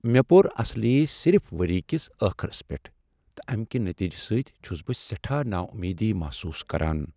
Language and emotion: Kashmiri, sad